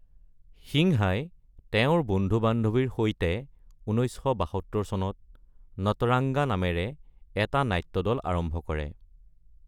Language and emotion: Assamese, neutral